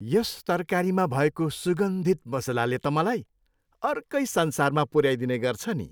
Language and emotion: Nepali, happy